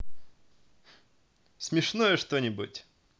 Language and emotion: Russian, positive